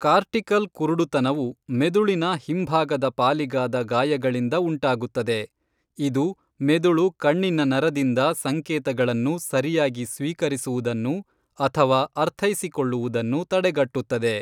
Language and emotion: Kannada, neutral